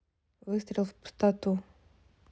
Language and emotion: Russian, neutral